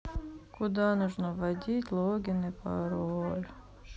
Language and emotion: Russian, sad